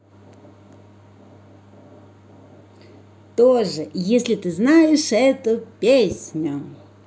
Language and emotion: Russian, positive